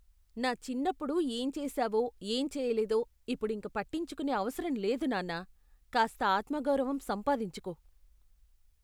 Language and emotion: Telugu, disgusted